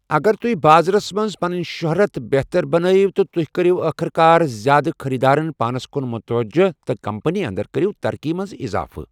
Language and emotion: Kashmiri, neutral